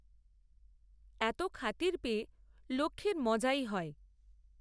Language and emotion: Bengali, neutral